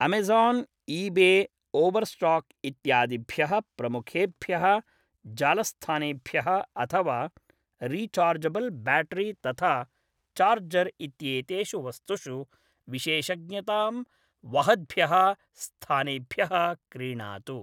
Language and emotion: Sanskrit, neutral